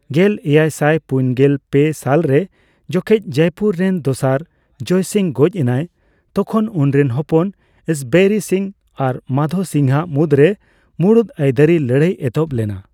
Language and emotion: Santali, neutral